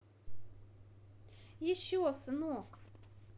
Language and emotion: Russian, positive